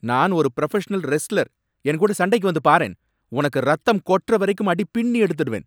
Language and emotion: Tamil, angry